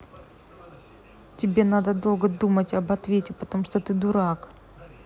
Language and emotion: Russian, angry